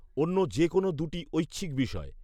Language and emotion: Bengali, neutral